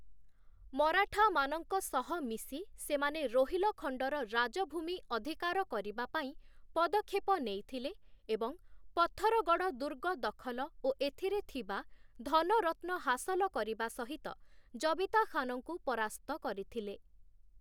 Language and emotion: Odia, neutral